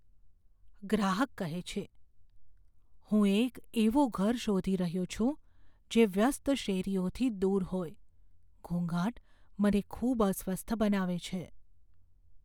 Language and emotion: Gujarati, fearful